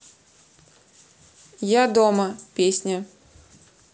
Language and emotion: Russian, neutral